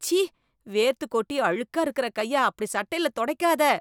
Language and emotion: Tamil, disgusted